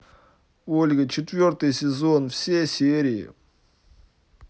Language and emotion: Russian, neutral